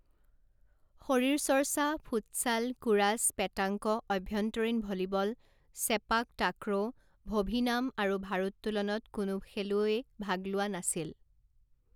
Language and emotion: Assamese, neutral